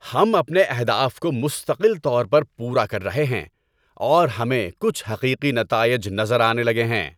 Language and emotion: Urdu, happy